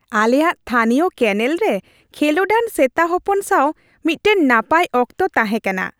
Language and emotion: Santali, happy